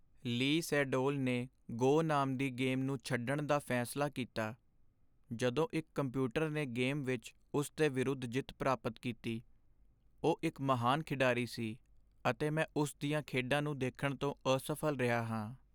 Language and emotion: Punjabi, sad